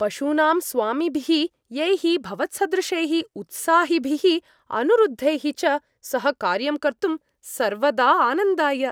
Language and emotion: Sanskrit, happy